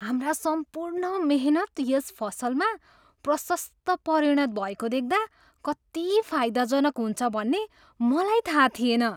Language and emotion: Nepali, surprised